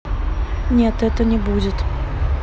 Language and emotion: Russian, neutral